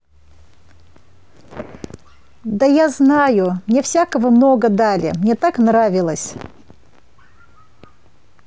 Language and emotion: Russian, positive